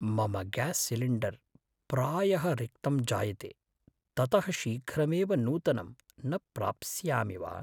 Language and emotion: Sanskrit, fearful